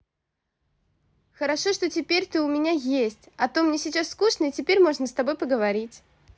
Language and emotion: Russian, positive